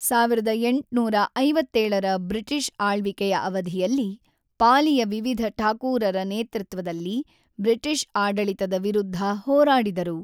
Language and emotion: Kannada, neutral